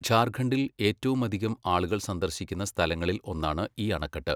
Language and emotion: Malayalam, neutral